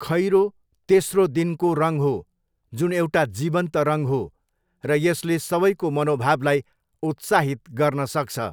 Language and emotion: Nepali, neutral